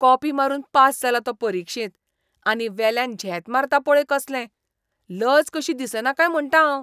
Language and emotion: Goan Konkani, disgusted